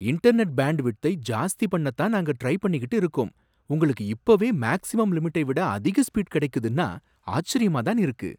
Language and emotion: Tamil, surprised